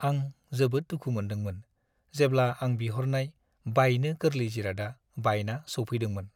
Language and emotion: Bodo, sad